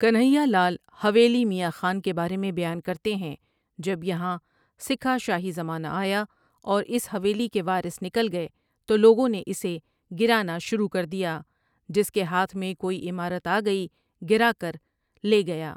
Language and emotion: Urdu, neutral